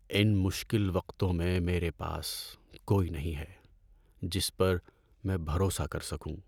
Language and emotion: Urdu, sad